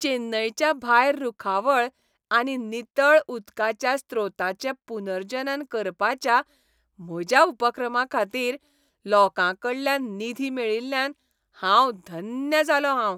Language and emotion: Goan Konkani, happy